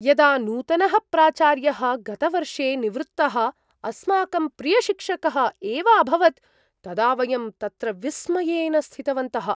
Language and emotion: Sanskrit, surprised